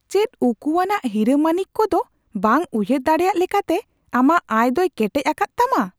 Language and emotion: Santali, surprised